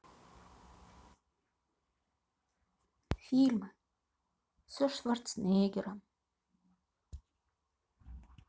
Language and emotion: Russian, sad